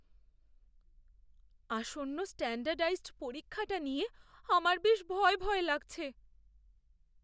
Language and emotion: Bengali, fearful